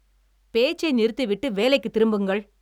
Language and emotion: Tamil, angry